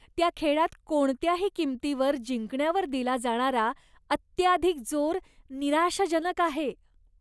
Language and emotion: Marathi, disgusted